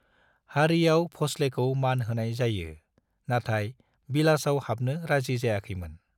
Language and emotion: Bodo, neutral